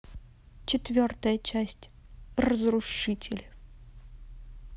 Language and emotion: Russian, neutral